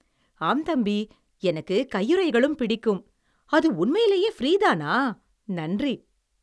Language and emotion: Tamil, happy